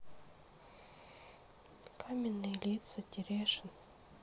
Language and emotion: Russian, sad